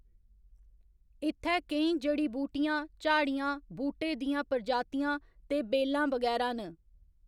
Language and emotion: Dogri, neutral